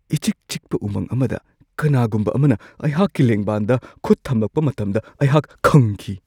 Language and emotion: Manipuri, surprised